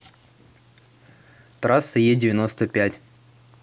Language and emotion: Russian, neutral